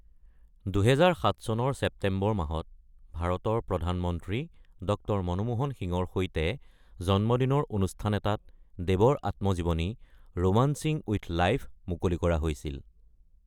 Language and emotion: Assamese, neutral